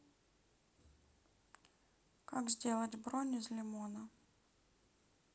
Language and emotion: Russian, sad